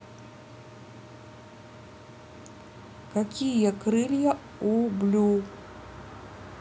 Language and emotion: Russian, neutral